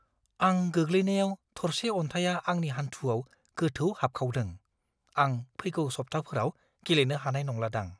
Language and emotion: Bodo, fearful